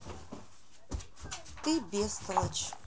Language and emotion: Russian, neutral